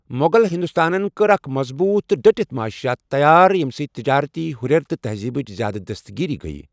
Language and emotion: Kashmiri, neutral